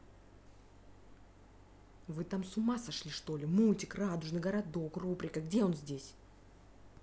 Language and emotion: Russian, angry